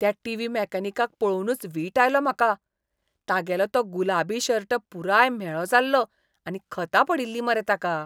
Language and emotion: Goan Konkani, disgusted